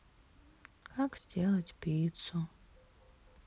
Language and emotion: Russian, sad